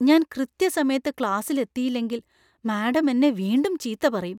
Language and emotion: Malayalam, fearful